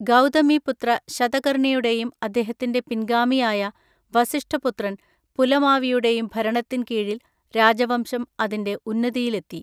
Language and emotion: Malayalam, neutral